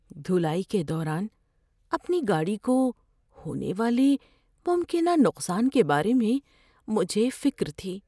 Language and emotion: Urdu, fearful